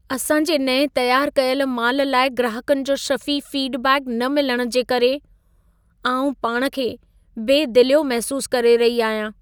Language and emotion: Sindhi, sad